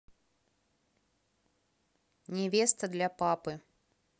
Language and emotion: Russian, neutral